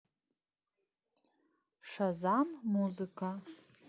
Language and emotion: Russian, neutral